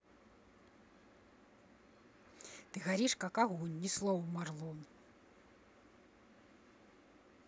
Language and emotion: Russian, angry